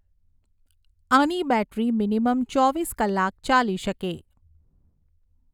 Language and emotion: Gujarati, neutral